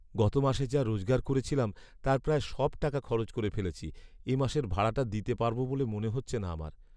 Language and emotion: Bengali, sad